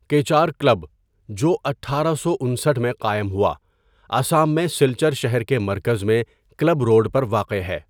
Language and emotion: Urdu, neutral